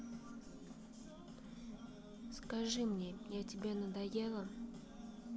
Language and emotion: Russian, sad